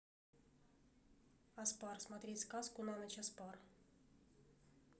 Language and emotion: Russian, neutral